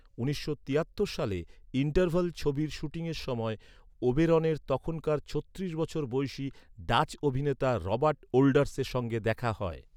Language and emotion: Bengali, neutral